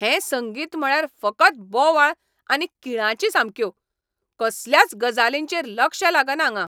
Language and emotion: Goan Konkani, angry